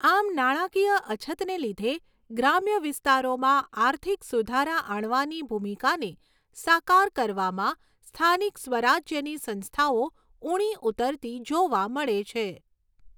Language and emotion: Gujarati, neutral